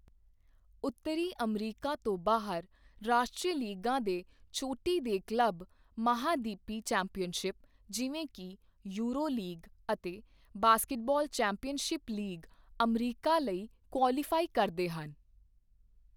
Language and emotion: Punjabi, neutral